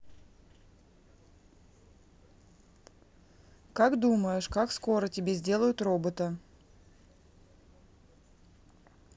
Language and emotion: Russian, neutral